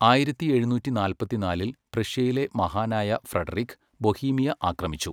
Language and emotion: Malayalam, neutral